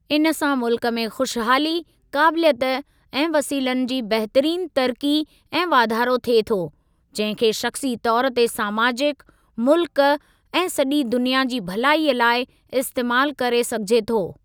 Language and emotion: Sindhi, neutral